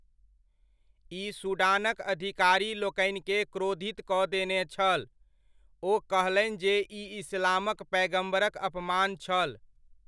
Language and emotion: Maithili, neutral